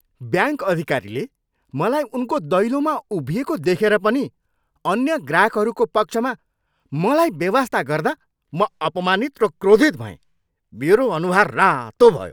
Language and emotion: Nepali, angry